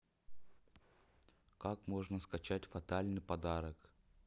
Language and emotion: Russian, neutral